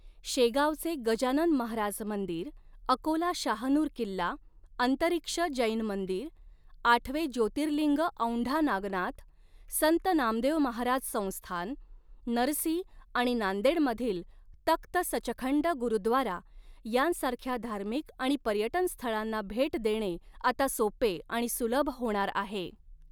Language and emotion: Marathi, neutral